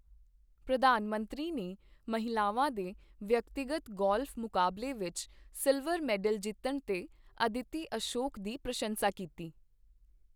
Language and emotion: Punjabi, neutral